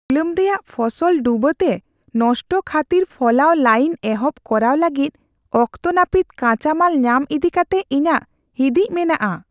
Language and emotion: Santali, fearful